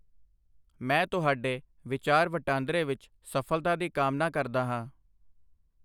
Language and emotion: Punjabi, neutral